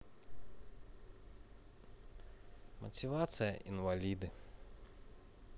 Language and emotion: Russian, sad